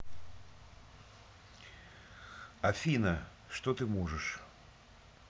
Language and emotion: Russian, neutral